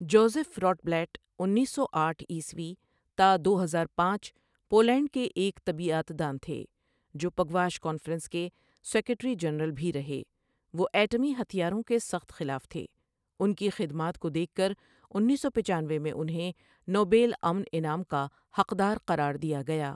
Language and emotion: Urdu, neutral